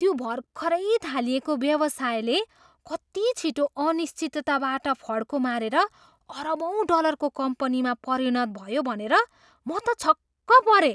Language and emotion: Nepali, surprised